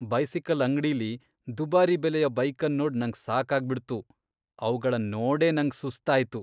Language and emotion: Kannada, disgusted